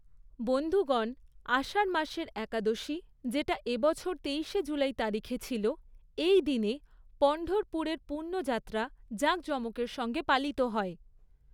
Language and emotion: Bengali, neutral